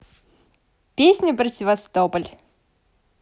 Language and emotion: Russian, positive